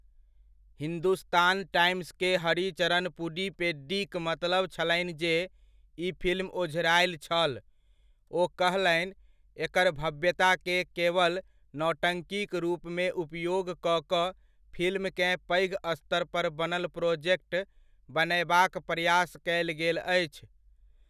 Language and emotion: Maithili, neutral